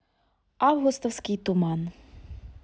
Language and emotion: Russian, neutral